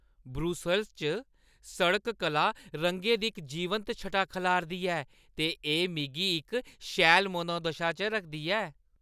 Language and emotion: Dogri, happy